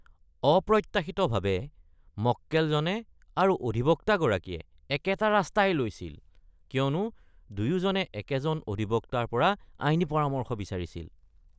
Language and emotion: Assamese, disgusted